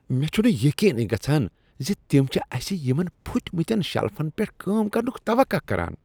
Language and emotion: Kashmiri, disgusted